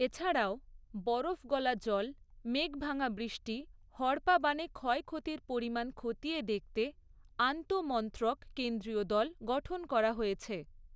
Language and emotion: Bengali, neutral